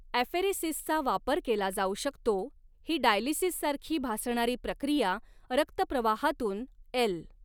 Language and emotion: Marathi, neutral